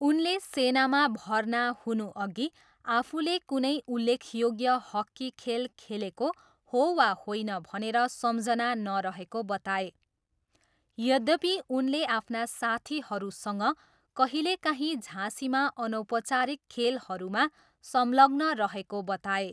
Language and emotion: Nepali, neutral